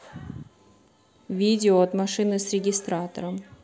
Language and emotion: Russian, neutral